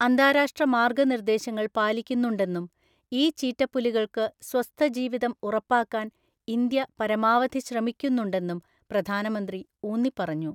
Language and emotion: Malayalam, neutral